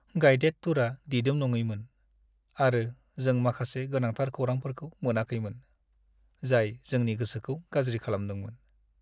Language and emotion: Bodo, sad